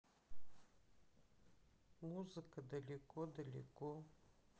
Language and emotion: Russian, sad